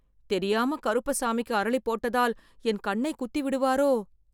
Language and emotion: Tamil, fearful